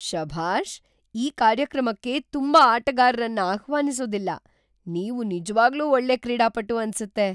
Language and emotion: Kannada, surprised